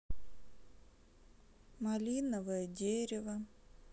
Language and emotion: Russian, sad